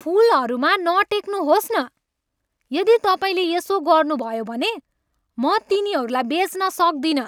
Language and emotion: Nepali, angry